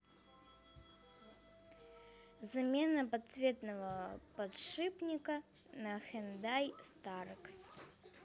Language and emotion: Russian, neutral